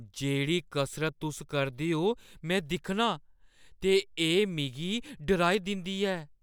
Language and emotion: Dogri, fearful